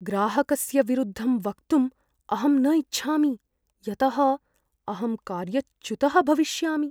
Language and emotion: Sanskrit, fearful